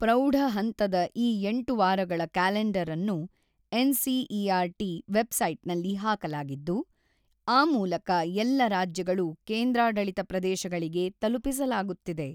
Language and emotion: Kannada, neutral